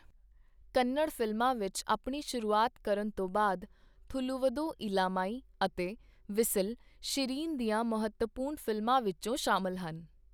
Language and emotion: Punjabi, neutral